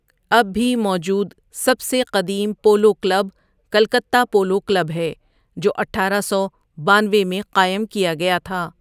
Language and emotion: Urdu, neutral